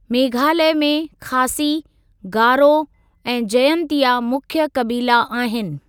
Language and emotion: Sindhi, neutral